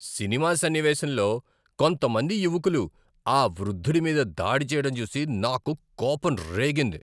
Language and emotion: Telugu, angry